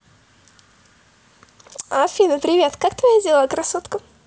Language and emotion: Russian, positive